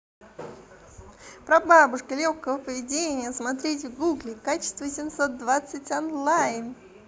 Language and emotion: Russian, positive